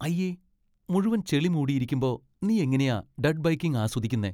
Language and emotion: Malayalam, disgusted